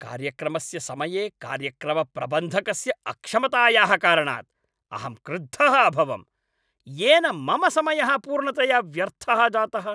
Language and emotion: Sanskrit, angry